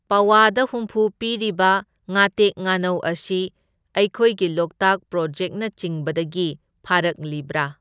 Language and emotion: Manipuri, neutral